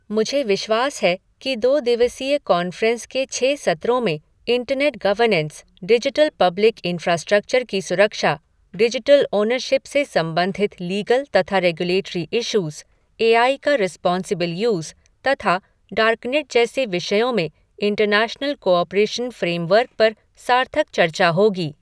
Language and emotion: Hindi, neutral